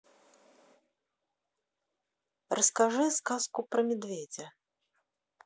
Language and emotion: Russian, neutral